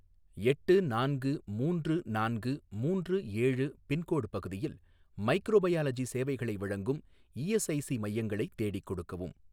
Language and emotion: Tamil, neutral